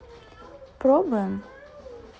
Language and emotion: Russian, neutral